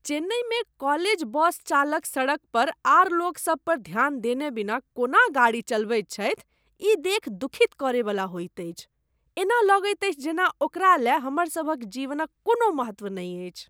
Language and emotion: Maithili, disgusted